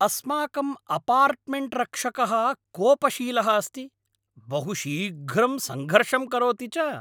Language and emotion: Sanskrit, angry